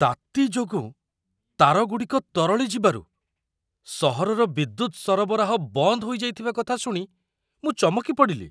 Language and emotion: Odia, surprised